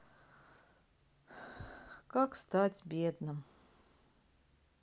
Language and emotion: Russian, sad